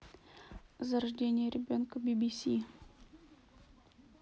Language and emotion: Russian, neutral